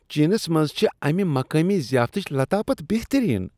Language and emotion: Kashmiri, disgusted